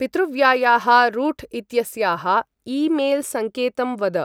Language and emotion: Sanskrit, neutral